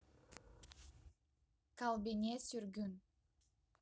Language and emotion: Russian, neutral